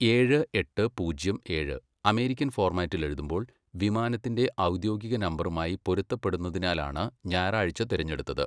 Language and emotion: Malayalam, neutral